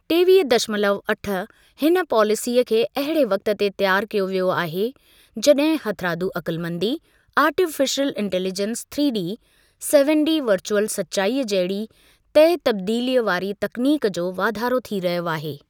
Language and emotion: Sindhi, neutral